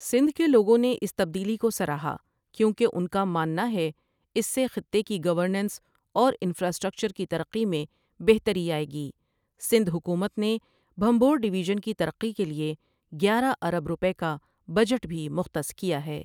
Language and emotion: Urdu, neutral